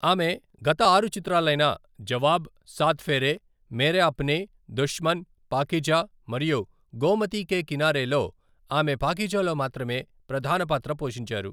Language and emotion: Telugu, neutral